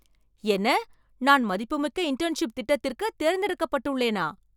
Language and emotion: Tamil, surprised